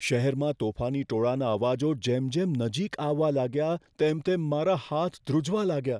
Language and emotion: Gujarati, fearful